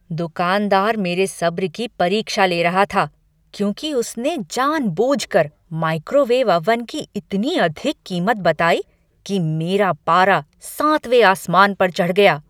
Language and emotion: Hindi, angry